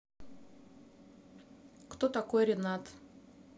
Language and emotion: Russian, neutral